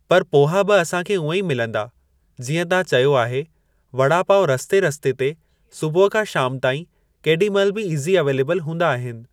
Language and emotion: Sindhi, neutral